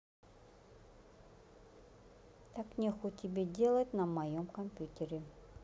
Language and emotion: Russian, neutral